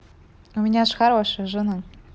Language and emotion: Russian, positive